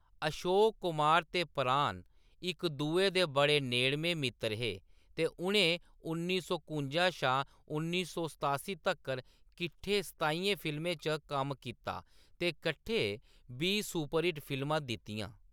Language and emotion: Dogri, neutral